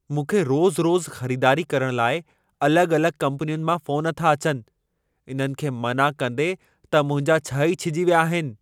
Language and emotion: Sindhi, angry